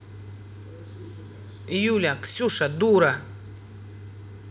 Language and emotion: Russian, angry